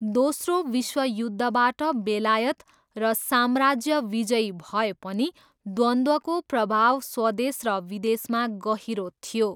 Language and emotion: Nepali, neutral